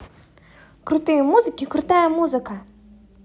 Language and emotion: Russian, positive